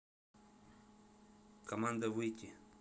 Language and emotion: Russian, neutral